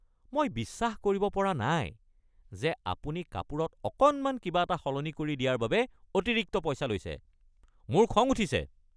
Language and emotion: Assamese, angry